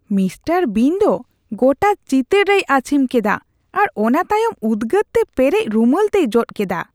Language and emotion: Santali, disgusted